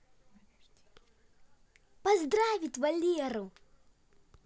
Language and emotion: Russian, positive